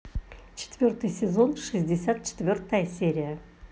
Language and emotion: Russian, positive